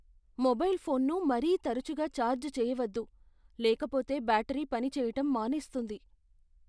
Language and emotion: Telugu, fearful